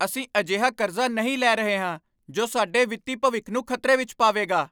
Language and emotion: Punjabi, angry